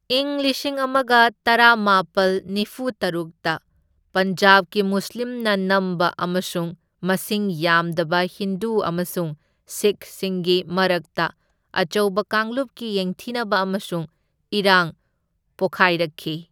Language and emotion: Manipuri, neutral